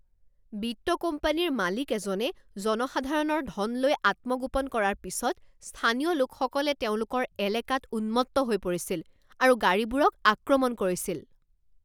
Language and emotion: Assamese, angry